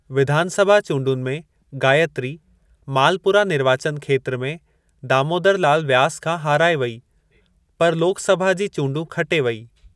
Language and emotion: Sindhi, neutral